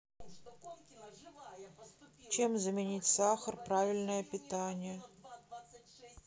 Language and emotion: Russian, sad